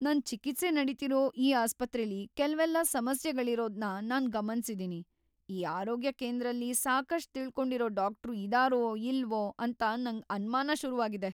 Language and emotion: Kannada, fearful